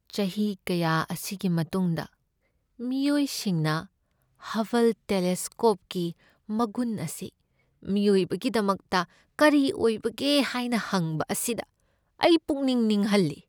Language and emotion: Manipuri, sad